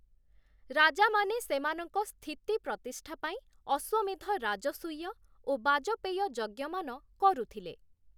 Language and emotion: Odia, neutral